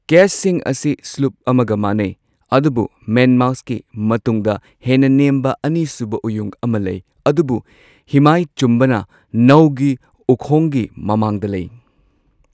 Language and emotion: Manipuri, neutral